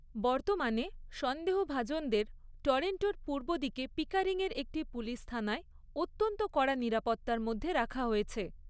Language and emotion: Bengali, neutral